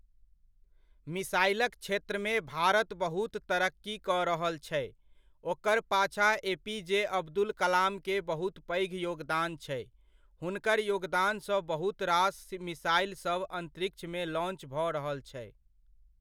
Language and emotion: Maithili, neutral